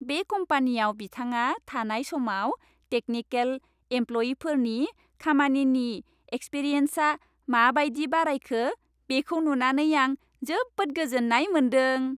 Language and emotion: Bodo, happy